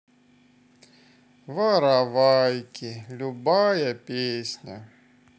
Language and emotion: Russian, sad